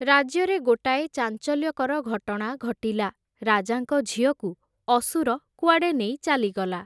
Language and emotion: Odia, neutral